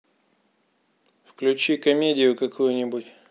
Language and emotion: Russian, neutral